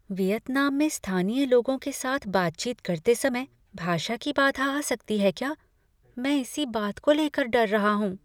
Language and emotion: Hindi, fearful